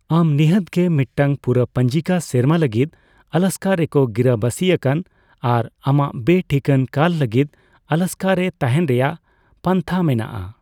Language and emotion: Santali, neutral